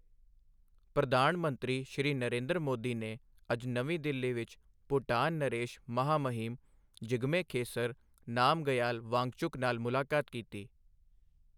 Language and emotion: Punjabi, neutral